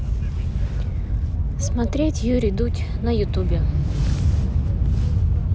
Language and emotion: Russian, neutral